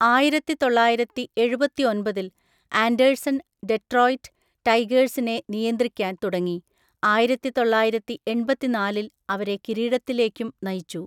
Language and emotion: Malayalam, neutral